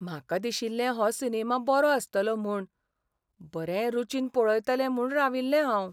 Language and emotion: Goan Konkani, sad